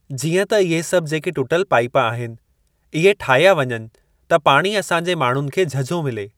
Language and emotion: Sindhi, neutral